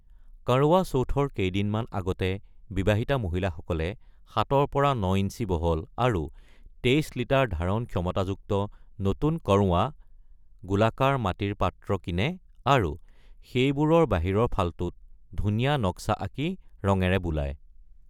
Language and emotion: Assamese, neutral